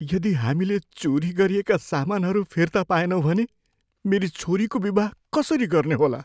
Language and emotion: Nepali, fearful